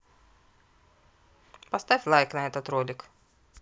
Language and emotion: Russian, neutral